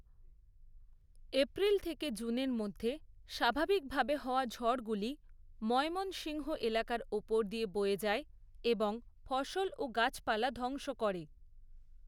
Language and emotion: Bengali, neutral